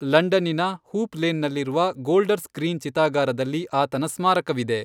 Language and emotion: Kannada, neutral